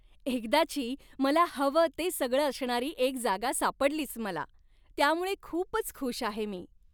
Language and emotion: Marathi, happy